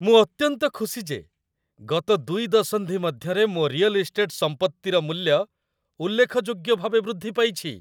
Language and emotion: Odia, happy